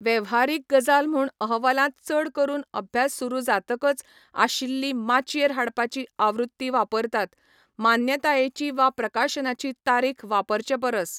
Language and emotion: Goan Konkani, neutral